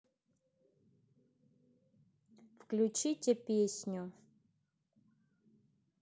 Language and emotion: Russian, neutral